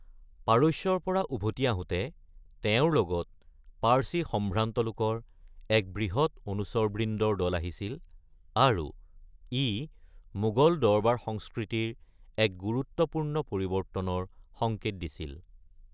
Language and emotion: Assamese, neutral